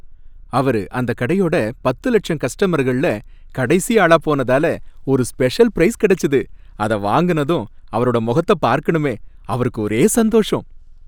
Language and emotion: Tamil, happy